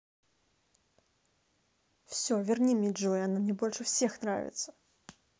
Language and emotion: Russian, angry